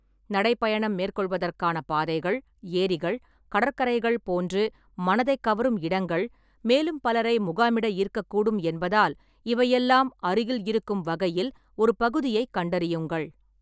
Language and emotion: Tamil, neutral